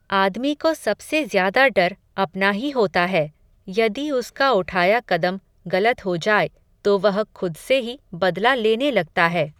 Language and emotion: Hindi, neutral